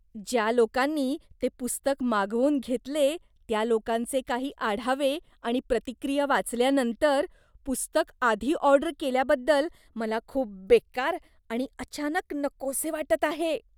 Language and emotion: Marathi, disgusted